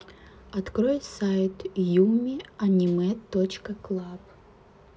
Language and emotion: Russian, neutral